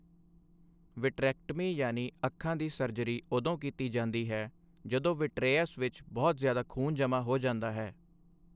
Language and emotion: Punjabi, neutral